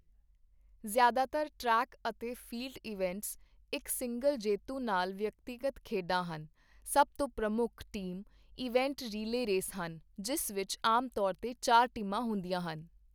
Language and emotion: Punjabi, neutral